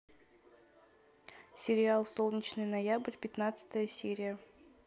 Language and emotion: Russian, neutral